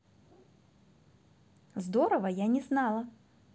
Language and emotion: Russian, positive